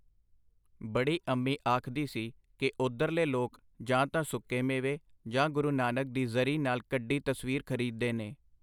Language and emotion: Punjabi, neutral